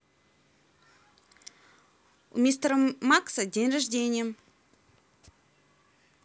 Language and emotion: Russian, neutral